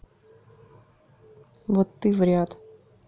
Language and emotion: Russian, neutral